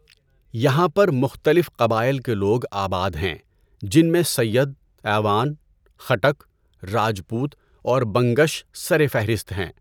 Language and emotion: Urdu, neutral